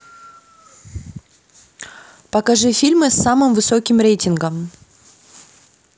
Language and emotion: Russian, neutral